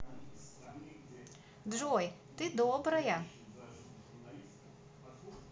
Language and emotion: Russian, positive